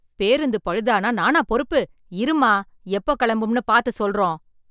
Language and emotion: Tamil, angry